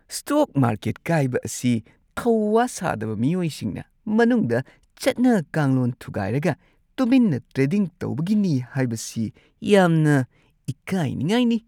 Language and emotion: Manipuri, disgusted